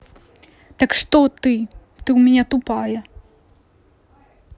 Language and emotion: Russian, angry